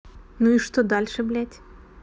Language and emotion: Russian, neutral